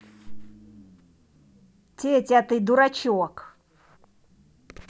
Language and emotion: Russian, angry